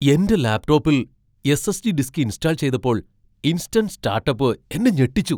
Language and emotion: Malayalam, surprised